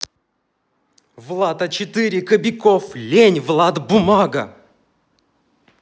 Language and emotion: Russian, angry